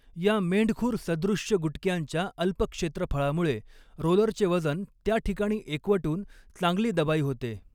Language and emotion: Marathi, neutral